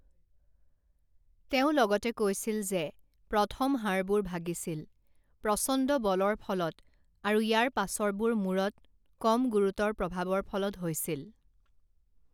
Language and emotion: Assamese, neutral